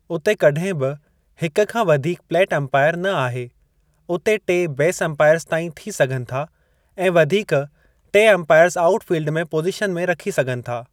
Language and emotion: Sindhi, neutral